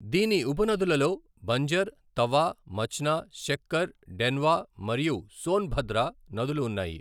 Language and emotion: Telugu, neutral